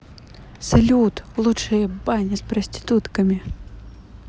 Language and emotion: Russian, neutral